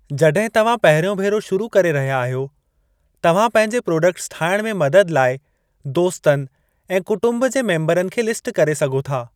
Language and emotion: Sindhi, neutral